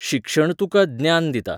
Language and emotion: Goan Konkani, neutral